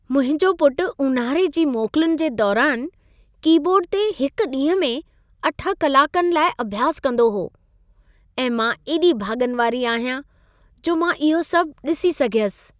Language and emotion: Sindhi, happy